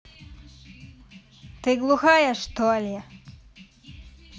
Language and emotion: Russian, angry